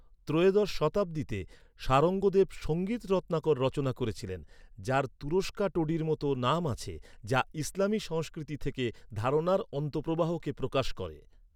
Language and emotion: Bengali, neutral